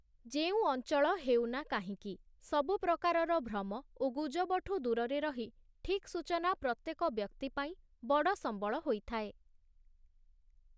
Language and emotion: Odia, neutral